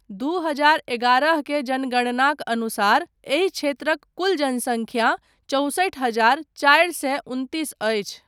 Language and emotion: Maithili, neutral